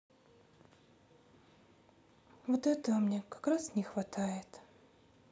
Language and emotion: Russian, sad